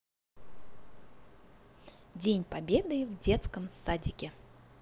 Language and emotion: Russian, positive